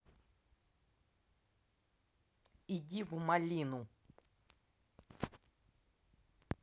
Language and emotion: Russian, angry